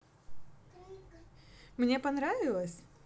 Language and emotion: Russian, positive